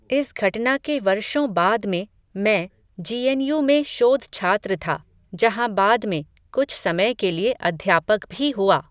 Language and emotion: Hindi, neutral